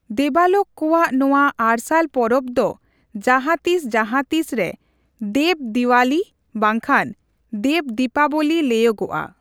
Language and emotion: Santali, neutral